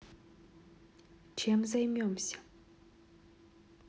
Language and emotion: Russian, neutral